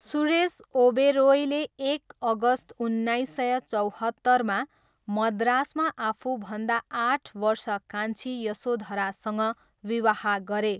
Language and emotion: Nepali, neutral